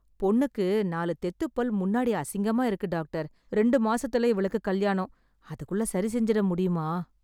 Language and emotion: Tamil, sad